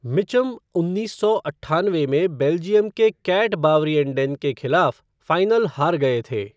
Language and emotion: Hindi, neutral